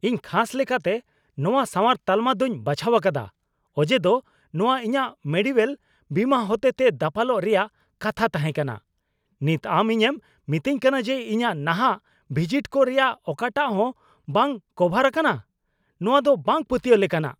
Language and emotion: Santali, angry